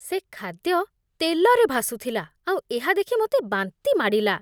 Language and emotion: Odia, disgusted